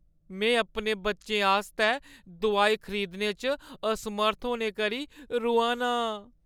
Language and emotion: Dogri, sad